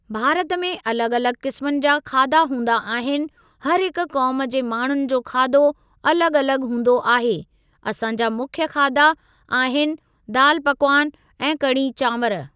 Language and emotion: Sindhi, neutral